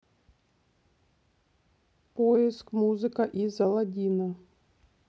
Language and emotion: Russian, neutral